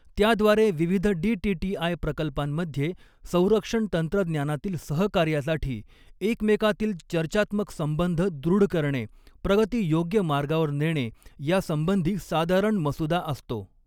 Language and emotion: Marathi, neutral